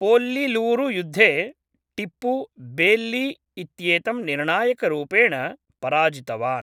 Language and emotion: Sanskrit, neutral